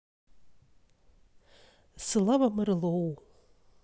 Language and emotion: Russian, neutral